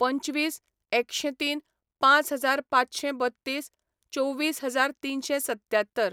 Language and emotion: Goan Konkani, neutral